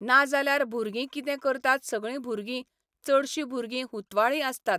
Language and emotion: Goan Konkani, neutral